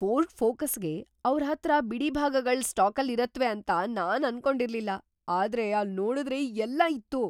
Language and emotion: Kannada, surprised